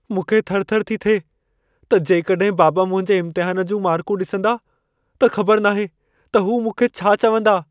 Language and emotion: Sindhi, fearful